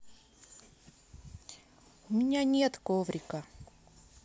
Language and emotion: Russian, sad